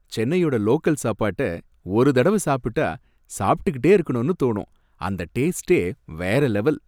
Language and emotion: Tamil, happy